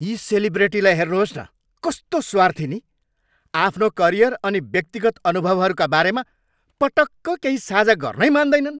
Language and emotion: Nepali, angry